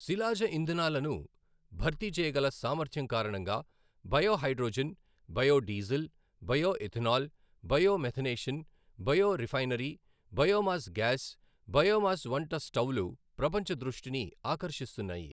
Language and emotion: Telugu, neutral